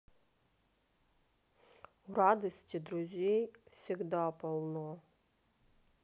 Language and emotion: Russian, neutral